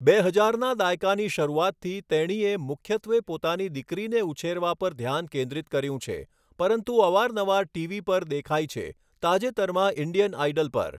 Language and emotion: Gujarati, neutral